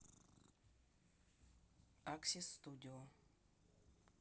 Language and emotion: Russian, neutral